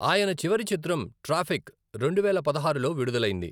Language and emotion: Telugu, neutral